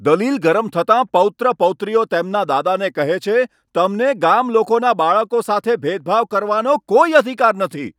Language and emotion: Gujarati, angry